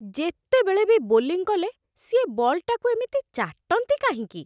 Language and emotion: Odia, disgusted